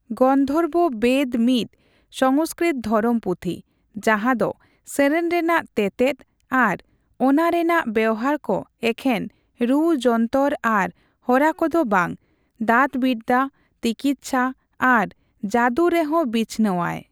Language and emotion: Santali, neutral